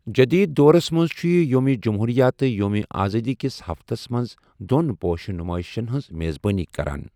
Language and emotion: Kashmiri, neutral